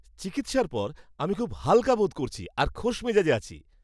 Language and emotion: Bengali, happy